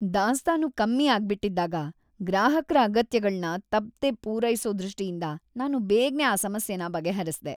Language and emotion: Kannada, happy